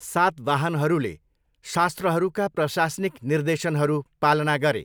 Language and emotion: Nepali, neutral